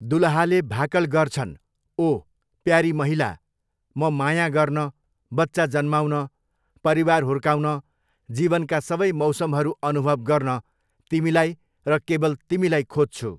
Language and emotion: Nepali, neutral